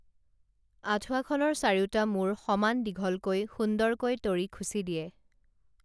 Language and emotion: Assamese, neutral